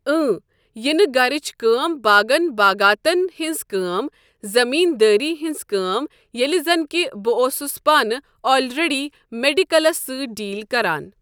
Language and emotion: Kashmiri, neutral